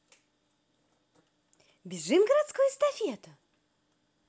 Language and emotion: Russian, positive